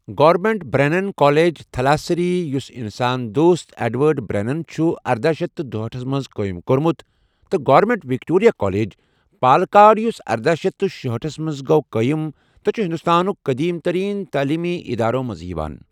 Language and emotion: Kashmiri, neutral